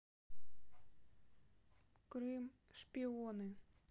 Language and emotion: Russian, neutral